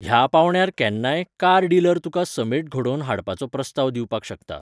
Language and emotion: Goan Konkani, neutral